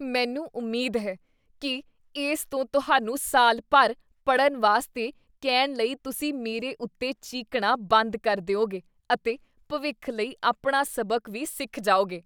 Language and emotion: Punjabi, disgusted